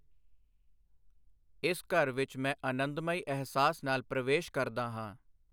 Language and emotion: Punjabi, neutral